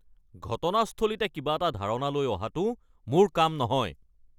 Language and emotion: Assamese, angry